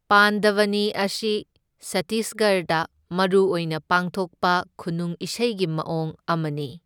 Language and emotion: Manipuri, neutral